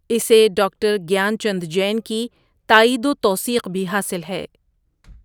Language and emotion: Urdu, neutral